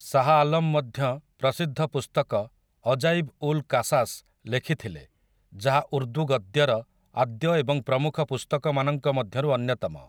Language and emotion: Odia, neutral